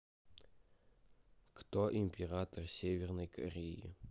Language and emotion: Russian, neutral